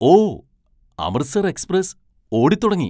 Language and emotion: Malayalam, surprised